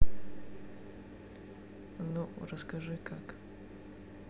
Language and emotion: Russian, neutral